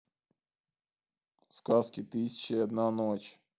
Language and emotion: Russian, neutral